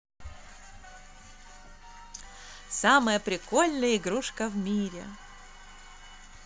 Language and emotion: Russian, positive